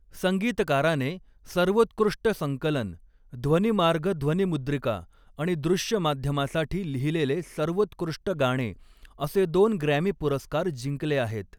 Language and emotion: Marathi, neutral